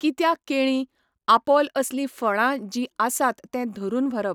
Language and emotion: Goan Konkani, neutral